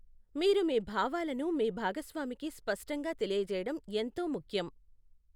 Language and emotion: Telugu, neutral